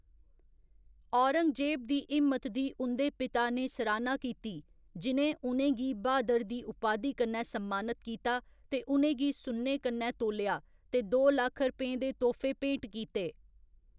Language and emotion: Dogri, neutral